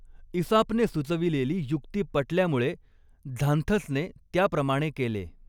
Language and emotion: Marathi, neutral